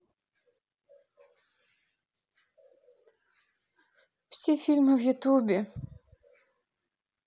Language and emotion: Russian, sad